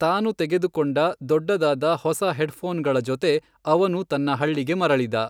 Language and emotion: Kannada, neutral